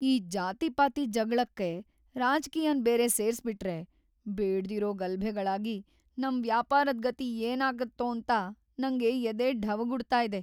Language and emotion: Kannada, fearful